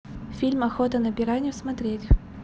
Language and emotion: Russian, neutral